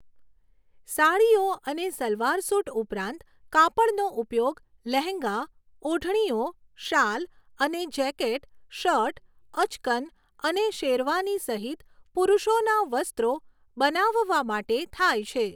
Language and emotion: Gujarati, neutral